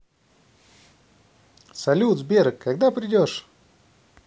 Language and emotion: Russian, positive